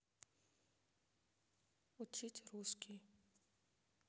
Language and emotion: Russian, neutral